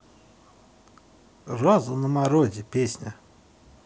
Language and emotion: Russian, positive